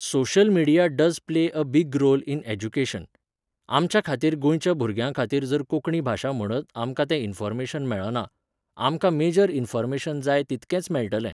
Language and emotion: Goan Konkani, neutral